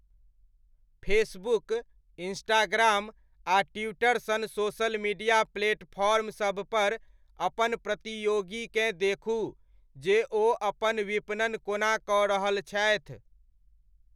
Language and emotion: Maithili, neutral